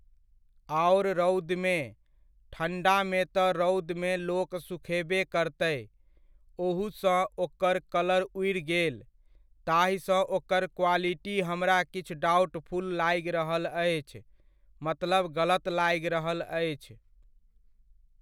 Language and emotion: Maithili, neutral